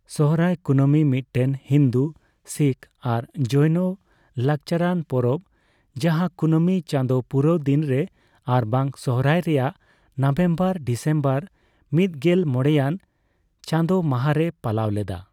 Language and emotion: Santali, neutral